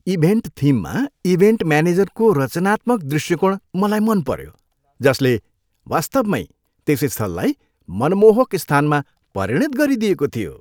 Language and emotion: Nepali, happy